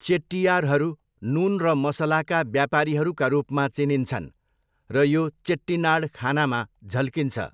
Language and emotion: Nepali, neutral